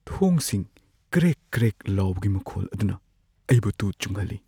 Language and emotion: Manipuri, fearful